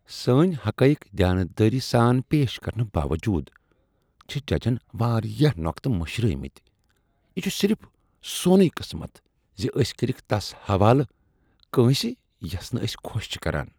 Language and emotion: Kashmiri, disgusted